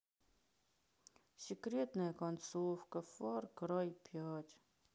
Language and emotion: Russian, sad